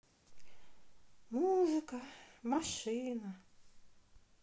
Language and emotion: Russian, sad